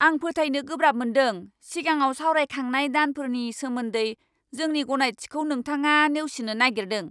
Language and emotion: Bodo, angry